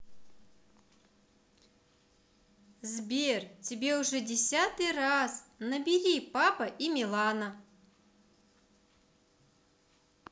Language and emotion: Russian, neutral